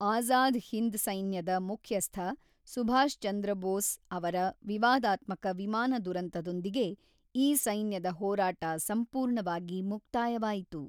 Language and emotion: Kannada, neutral